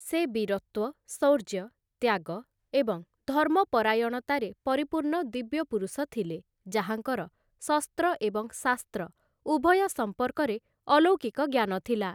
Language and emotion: Odia, neutral